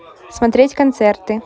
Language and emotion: Russian, neutral